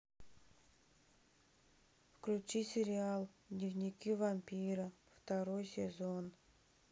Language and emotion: Russian, sad